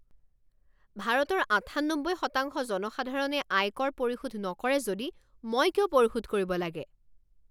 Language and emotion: Assamese, angry